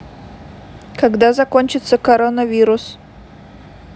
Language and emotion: Russian, neutral